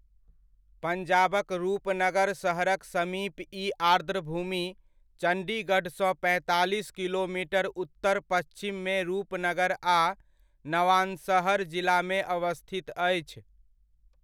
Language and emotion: Maithili, neutral